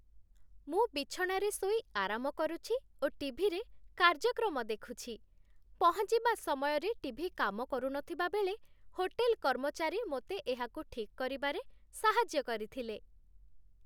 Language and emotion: Odia, happy